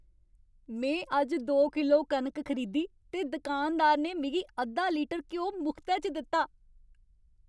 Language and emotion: Dogri, happy